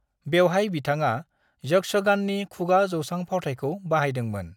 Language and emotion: Bodo, neutral